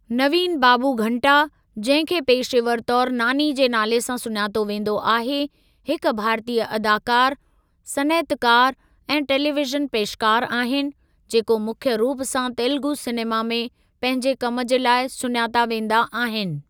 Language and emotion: Sindhi, neutral